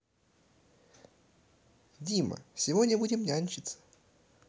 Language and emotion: Russian, positive